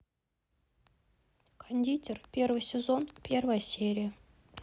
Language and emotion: Russian, neutral